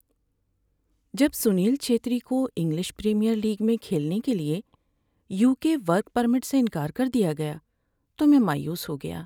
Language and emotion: Urdu, sad